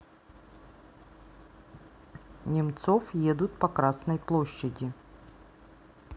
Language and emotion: Russian, neutral